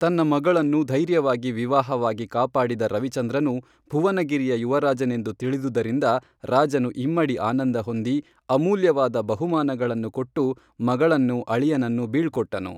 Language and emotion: Kannada, neutral